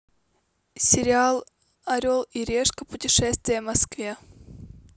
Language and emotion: Russian, neutral